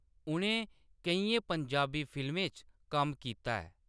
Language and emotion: Dogri, neutral